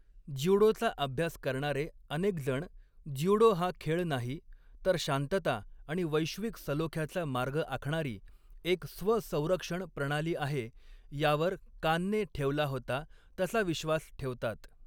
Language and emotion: Marathi, neutral